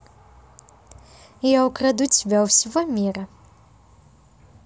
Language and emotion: Russian, positive